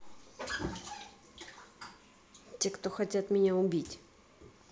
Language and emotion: Russian, neutral